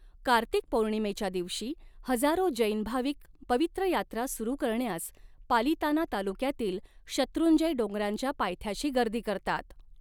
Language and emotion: Marathi, neutral